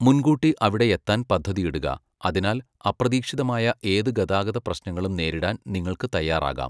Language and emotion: Malayalam, neutral